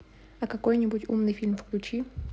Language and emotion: Russian, neutral